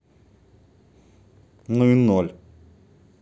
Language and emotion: Russian, neutral